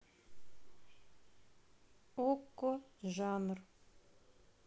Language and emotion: Russian, neutral